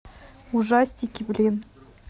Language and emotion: Russian, neutral